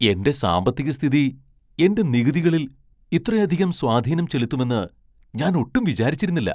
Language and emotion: Malayalam, surprised